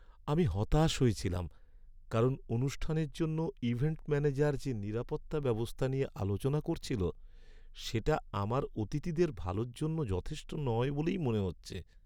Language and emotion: Bengali, sad